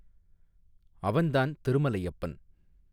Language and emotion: Tamil, neutral